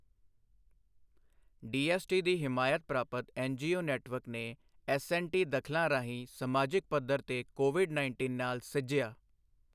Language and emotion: Punjabi, neutral